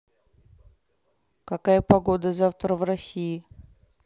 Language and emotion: Russian, neutral